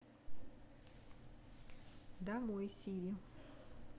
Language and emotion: Russian, neutral